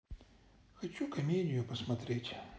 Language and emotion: Russian, sad